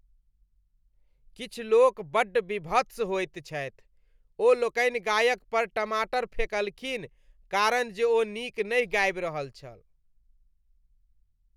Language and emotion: Maithili, disgusted